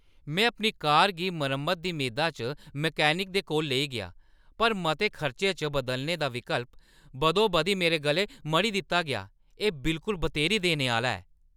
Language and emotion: Dogri, angry